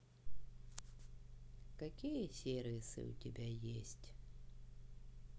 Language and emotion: Russian, sad